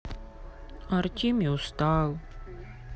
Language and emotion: Russian, sad